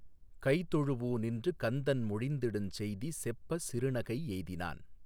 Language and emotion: Tamil, neutral